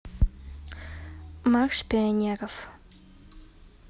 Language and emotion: Russian, neutral